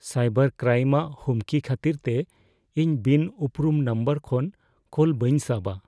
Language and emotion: Santali, fearful